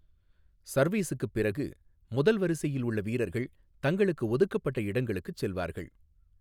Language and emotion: Tamil, neutral